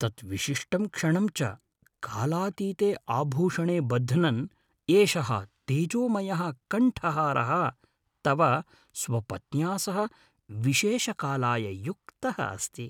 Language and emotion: Sanskrit, happy